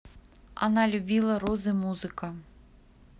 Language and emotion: Russian, neutral